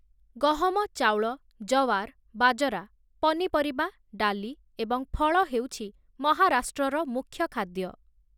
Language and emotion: Odia, neutral